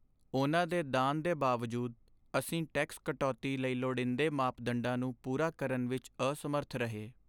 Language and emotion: Punjabi, sad